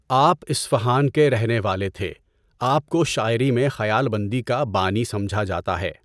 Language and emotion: Urdu, neutral